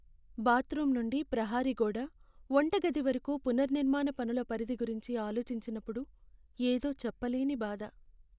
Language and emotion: Telugu, sad